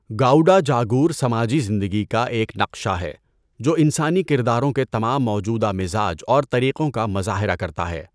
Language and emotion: Urdu, neutral